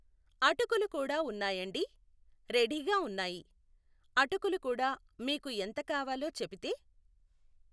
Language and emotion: Telugu, neutral